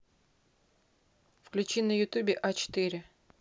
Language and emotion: Russian, neutral